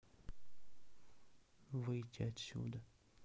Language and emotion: Russian, sad